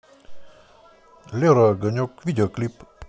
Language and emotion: Russian, neutral